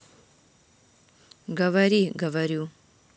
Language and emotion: Russian, neutral